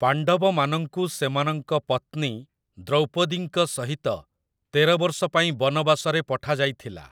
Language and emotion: Odia, neutral